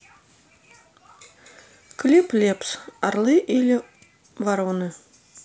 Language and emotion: Russian, neutral